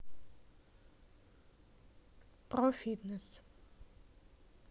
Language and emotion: Russian, neutral